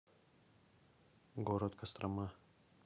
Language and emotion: Russian, neutral